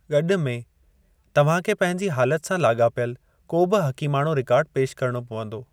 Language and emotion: Sindhi, neutral